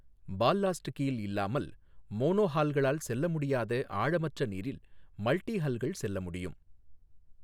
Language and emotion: Tamil, neutral